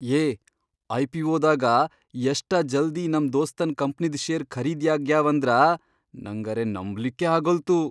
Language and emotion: Kannada, surprised